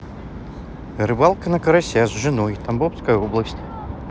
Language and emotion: Russian, neutral